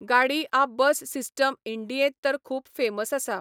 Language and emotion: Goan Konkani, neutral